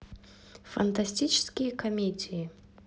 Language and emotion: Russian, neutral